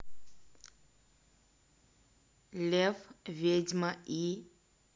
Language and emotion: Russian, neutral